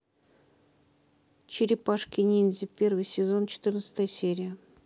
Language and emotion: Russian, neutral